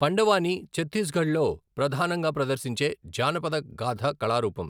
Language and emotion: Telugu, neutral